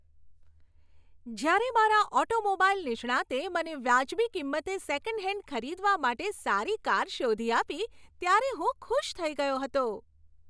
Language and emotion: Gujarati, happy